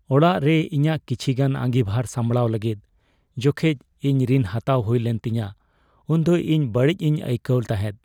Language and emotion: Santali, sad